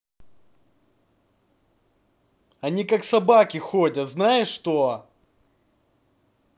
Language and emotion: Russian, angry